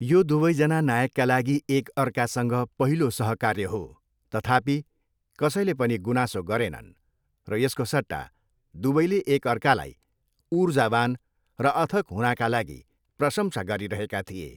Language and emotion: Nepali, neutral